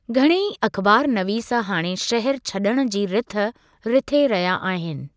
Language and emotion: Sindhi, neutral